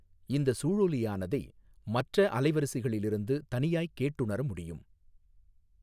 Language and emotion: Tamil, neutral